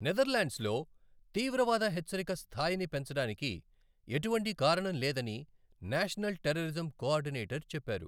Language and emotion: Telugu, neutral